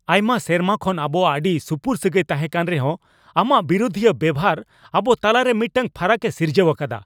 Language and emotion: Santali, angry